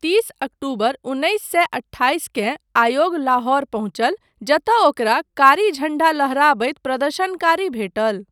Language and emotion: Maithili, neutral